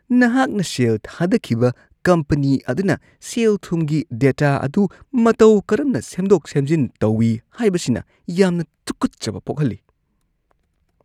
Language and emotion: Manipuri, disgusted